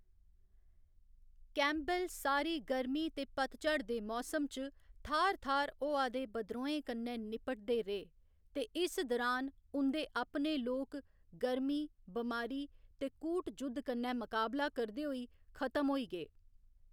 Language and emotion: Dogri, neutral